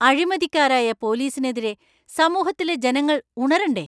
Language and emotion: Malayalam, angry